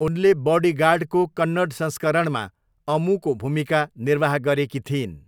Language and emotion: Nepali, neutral